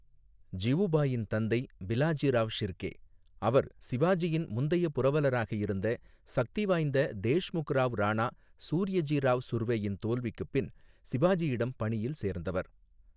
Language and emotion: Tamil, neutral